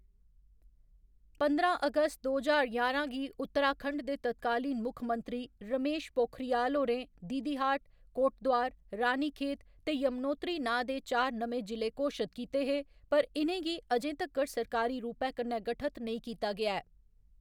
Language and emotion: Dogri, neutral